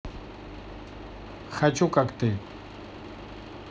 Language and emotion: Russian, neutral